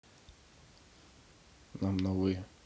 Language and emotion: Russian, neutral